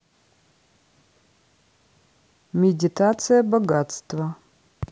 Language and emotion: Russian, neutral